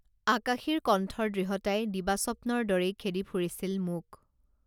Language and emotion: Assamese, neutral